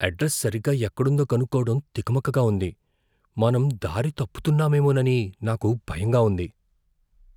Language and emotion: Telugu, fearful